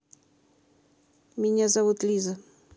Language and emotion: Russian, neutral